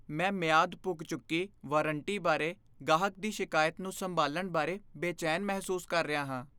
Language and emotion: Punjabi, fearful